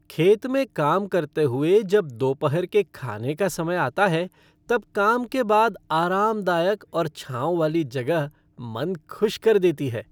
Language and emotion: Hindi, happy